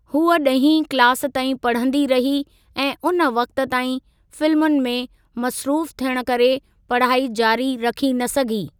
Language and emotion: Sindhi, neutral